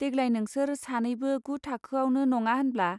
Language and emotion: Bodo, neutral